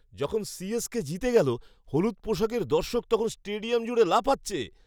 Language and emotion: Bengali, happy